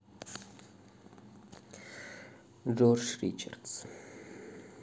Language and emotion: Russian, sad